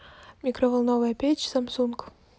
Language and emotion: Russian, neutral